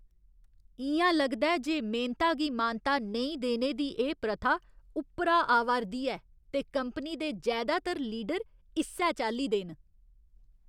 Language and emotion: Dogri, disgusted